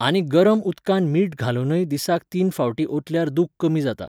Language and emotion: Goan Konkani, neutral